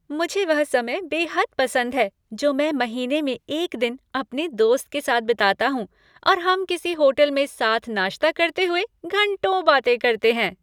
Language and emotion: Hindi, happy